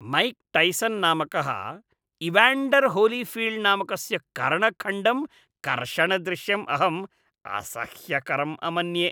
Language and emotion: Sanskrit, disgusted